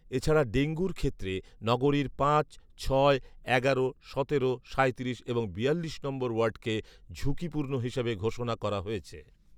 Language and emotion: Bengali, neutral